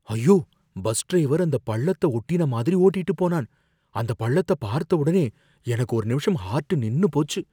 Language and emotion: Tamil, fearful